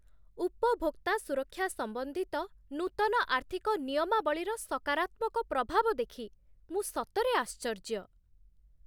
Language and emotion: Odia, surprised